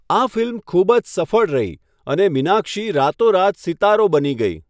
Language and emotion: Gujarati, neutral